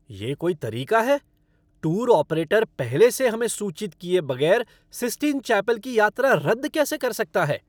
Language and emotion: Hindi, angry